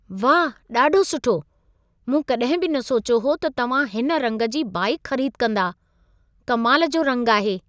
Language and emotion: Sindhi, surprised